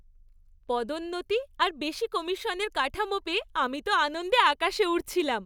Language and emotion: Bengali, happy